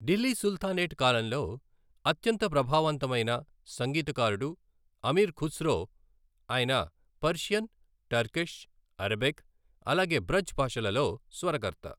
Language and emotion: Telugu, neutral